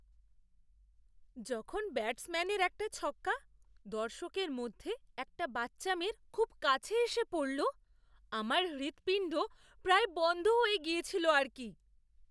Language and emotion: Bengali, surprised